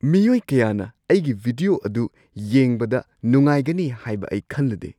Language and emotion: Manipuri, surprised